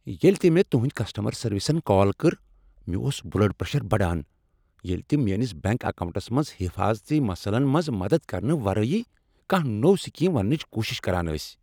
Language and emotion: Kashmiri, angry